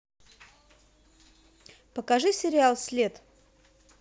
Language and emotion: Russian, neutral